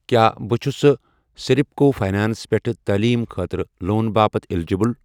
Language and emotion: Kashmiri, neutral